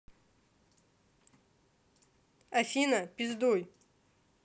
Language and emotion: Russian, angry